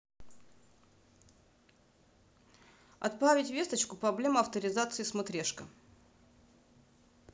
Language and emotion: Russian, neutral